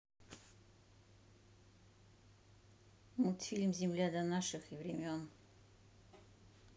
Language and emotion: Russian, neutral